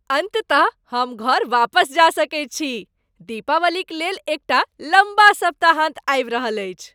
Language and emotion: Maithili, happy